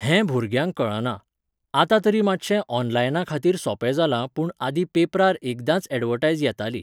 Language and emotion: Goan Konkani, neutral